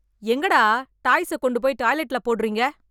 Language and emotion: Tamil, angry